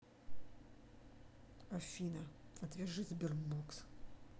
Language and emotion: Russian, neutral